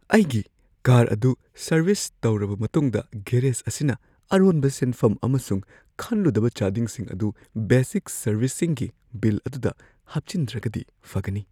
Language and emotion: Manipuri, fearful